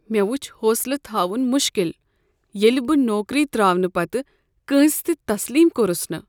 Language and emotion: Kashmiri, sad